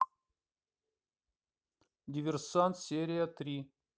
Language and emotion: Russian, neutral